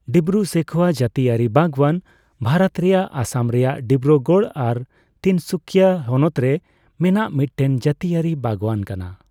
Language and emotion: Santali, neutral